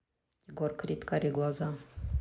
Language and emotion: Russian, neutral